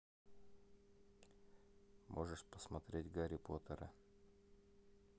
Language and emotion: Russian, neutral